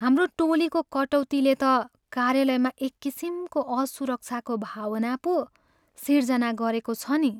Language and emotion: Nepali, sad